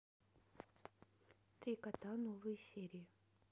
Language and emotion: Russian, neutral